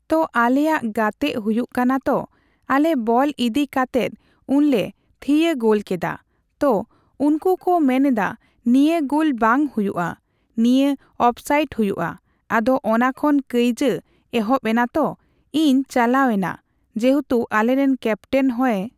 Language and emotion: Santali, neutral